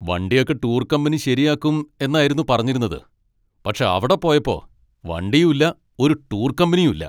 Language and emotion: Malayalam, angry